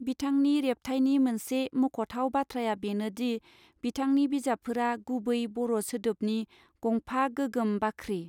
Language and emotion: Bodo, neutral